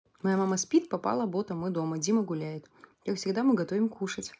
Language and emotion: Russian, neutral